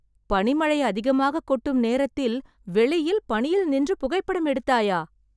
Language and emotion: Tamil, surprised